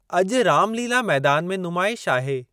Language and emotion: Sindhi, neutral